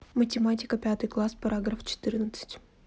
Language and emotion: Russian, neutral